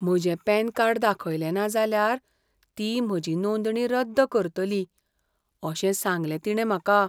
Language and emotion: Goan Konkani, fearful